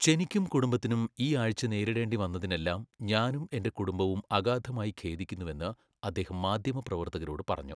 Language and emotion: Malayalam, neutral